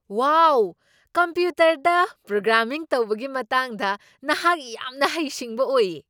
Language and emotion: Manipuri, surprised